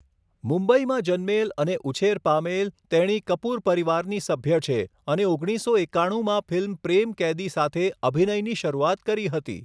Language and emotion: Gujarati, neutral